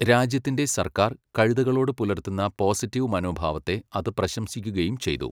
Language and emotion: Malayalam, neutral